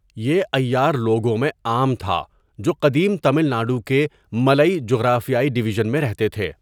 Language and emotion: Urdu, neutral